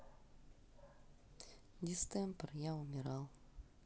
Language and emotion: Russian, sad